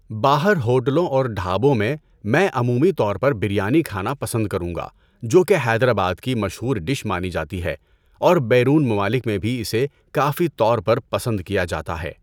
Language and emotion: Urdu, neutral